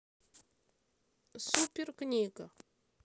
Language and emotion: Russian, neutral